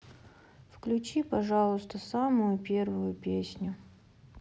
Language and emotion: Russian, sad